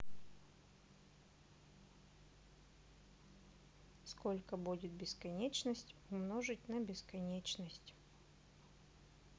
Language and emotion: Russian, neutral